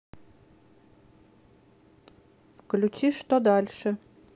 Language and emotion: Russian, neutral